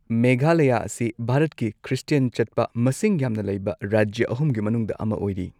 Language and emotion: Manipuri, neutral